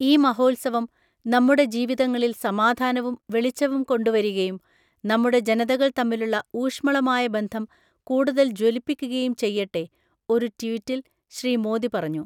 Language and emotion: Malayalam, neutral